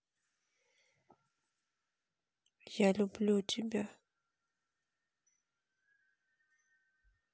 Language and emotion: Russian, sad